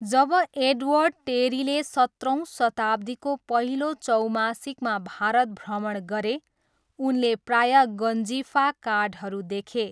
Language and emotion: Nepali, neutral